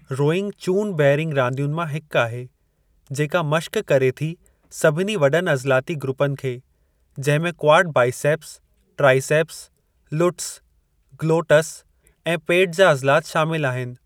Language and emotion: Sindhi, neutral